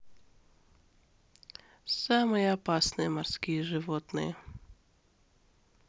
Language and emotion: Russian, neutral